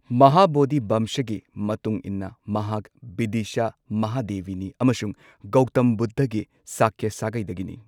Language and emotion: Manipuri, neutral